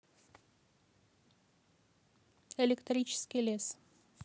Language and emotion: Russian, neutral